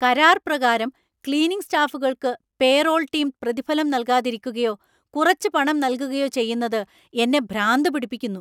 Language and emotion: Malayalam, angry